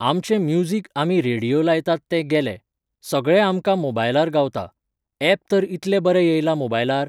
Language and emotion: Goan Konkani, neutral